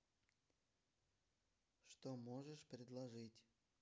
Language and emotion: Russian, neutral